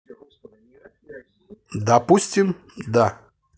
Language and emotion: Russian, positive